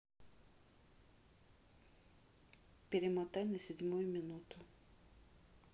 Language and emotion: Russian, neutral